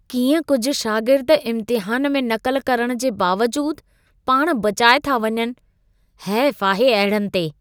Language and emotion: Sindhi, disgusted